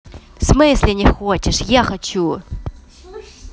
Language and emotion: Russian, angry